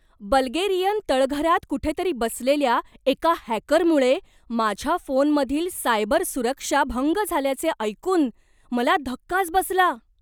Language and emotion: Marathi, surprised